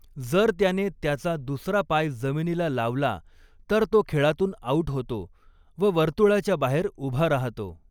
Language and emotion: Marathi, neutral